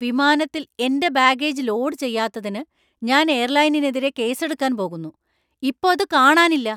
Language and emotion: Malayalam, angry